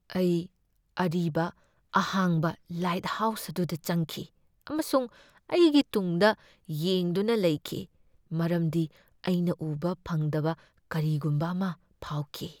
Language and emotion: Manipuri, fearful